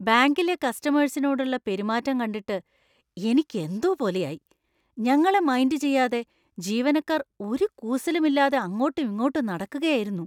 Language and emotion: Malayalam, disgusted